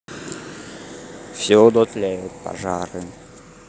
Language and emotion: Russian, neutral